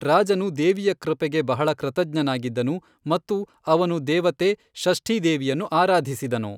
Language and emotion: Kannada, neutral